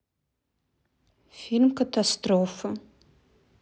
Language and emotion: Russian, sad